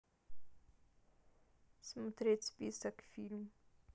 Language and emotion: Russian, neutral